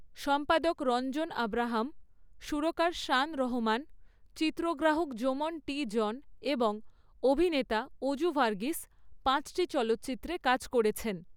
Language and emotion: Bengali, neutral